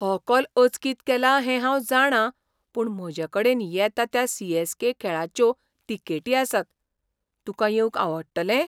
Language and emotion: Goan Konkani, surprised